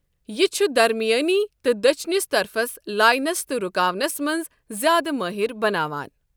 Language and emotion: Kashmiri, neutral